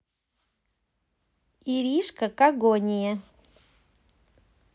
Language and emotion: Russian, positive